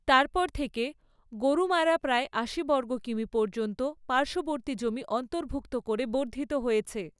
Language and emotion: Bengali, neutral